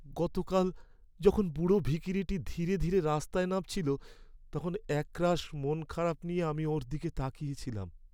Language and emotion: Bengali, sad